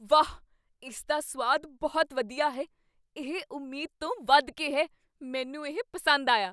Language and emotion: Punjabi, surprised